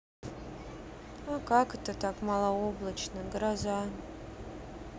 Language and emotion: Russian, sad